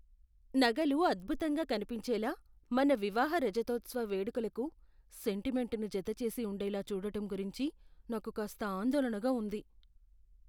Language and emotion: Telugu, fearful